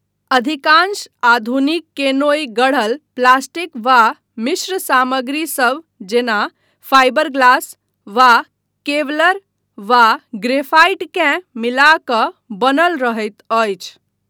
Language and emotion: Maithili, neutral